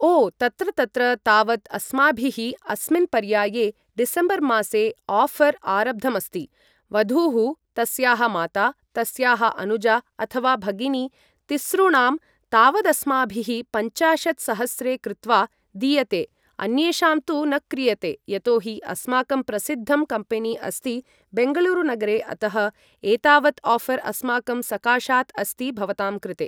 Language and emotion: Sanskrit, neutral